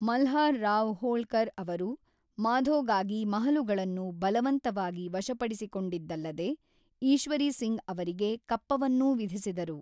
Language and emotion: Kannada, neutral